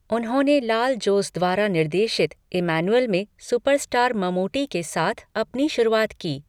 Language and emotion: Hindi, neutral